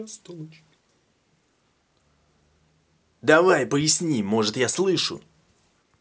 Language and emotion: Russian, angry